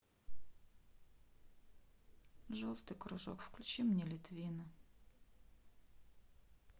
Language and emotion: Russian, sad